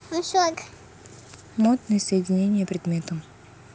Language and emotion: Russian, neutral